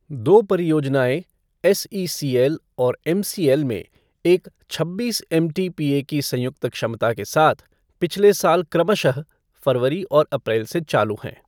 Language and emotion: Hindi, neutral